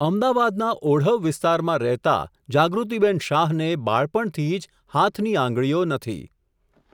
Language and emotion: Gujarati, neutral